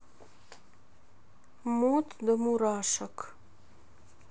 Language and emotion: Russian, neutral